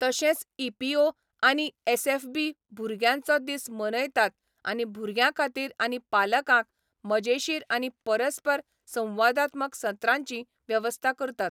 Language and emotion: Goan Konkani, neutral